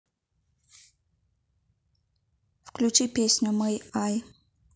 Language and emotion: Russian, neutral